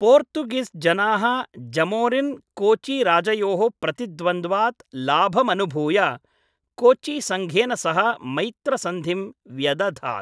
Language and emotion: Sanskrit, neutral